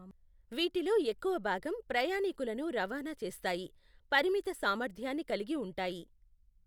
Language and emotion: Telugu, neutral